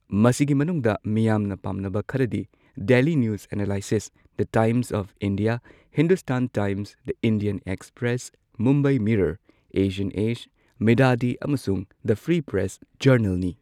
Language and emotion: Manipuri, neutral